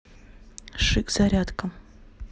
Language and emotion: Russian, neutral